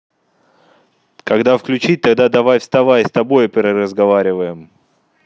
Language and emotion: Russian, neutral